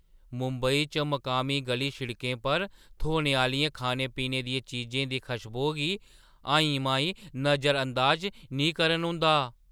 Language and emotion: Dogri, surprised